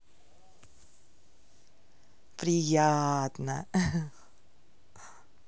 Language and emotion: Russian, positive